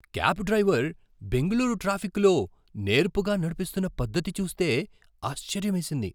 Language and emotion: Telugu, surprised